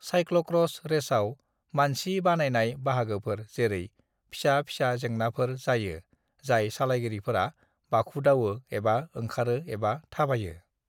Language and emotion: Bodo, neutral